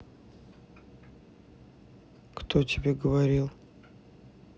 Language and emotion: Russian, neutral